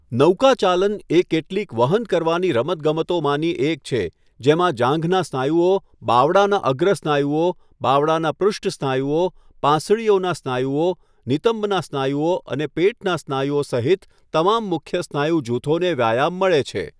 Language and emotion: Gujarati, neutral